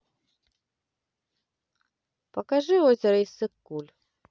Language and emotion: Russian, neutral